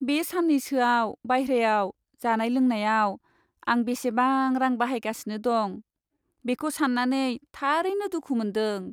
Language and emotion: Bodo, sad